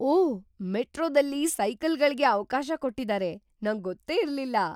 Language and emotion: Kannada, surprised